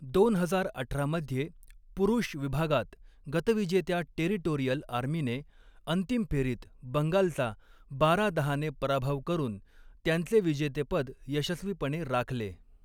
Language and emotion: Marathi, neutral